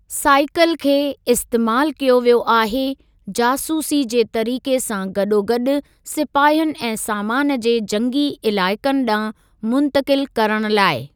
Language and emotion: Sindhi, neutral